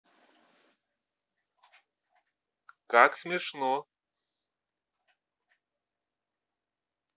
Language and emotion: Russian, neutral